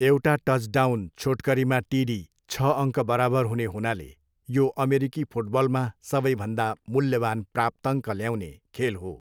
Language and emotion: Nepali, neutral